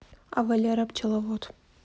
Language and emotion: Russian, neutral